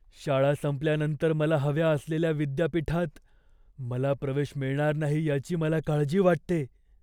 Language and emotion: Marathi, fearful